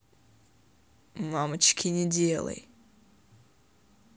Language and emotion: Russian, neutral